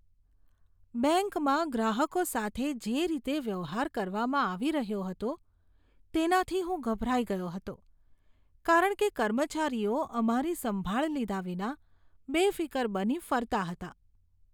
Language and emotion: Gujarati, disgusted